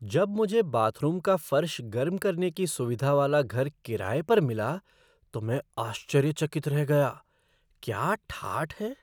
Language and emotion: Hindi, surprised